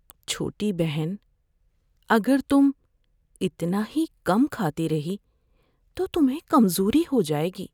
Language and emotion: Urdu, fearful